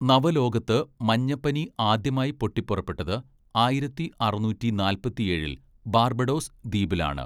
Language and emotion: Malayalam, neutral